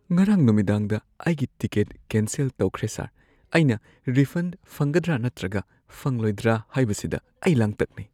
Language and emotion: Manipuri, fearful